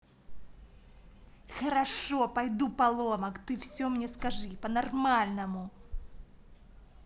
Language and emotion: Russian, angry